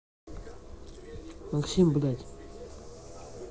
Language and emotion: Russian, angry